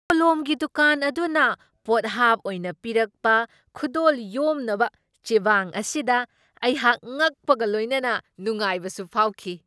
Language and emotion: Manipuri, surprised